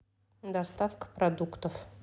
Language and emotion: Russian, neutral